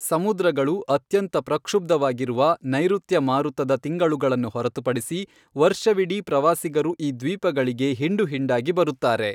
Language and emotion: Kannada, neutral